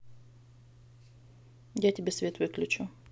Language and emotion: Russian, neutral